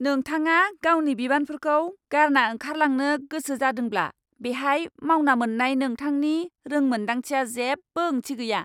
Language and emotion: Bodo, angry